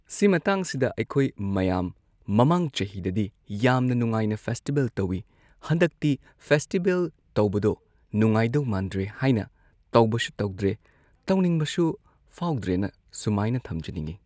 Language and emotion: Manipuri, neutral